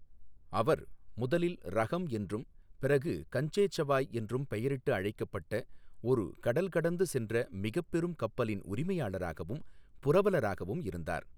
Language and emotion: Tamil, neutral